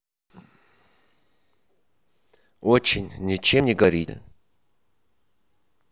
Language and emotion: Russian, neutral